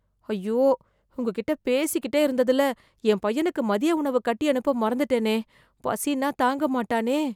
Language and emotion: Tamil, fearful